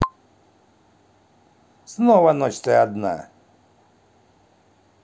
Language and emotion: Russian, neutral